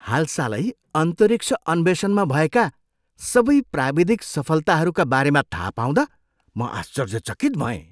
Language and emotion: Nepali, surprised